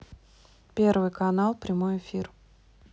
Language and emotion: Russian, neutral